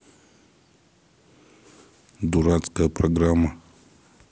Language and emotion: Russian, angry